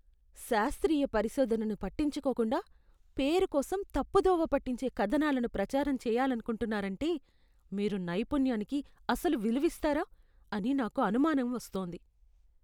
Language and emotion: Telugu, disgusted